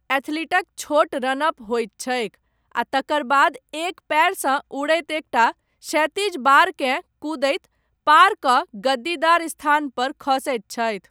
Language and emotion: Maithili, neutral